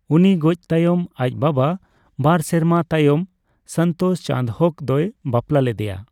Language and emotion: Santali, neutral